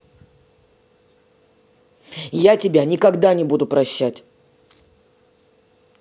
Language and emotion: Russian, angry